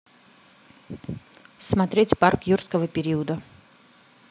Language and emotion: Russian, neutral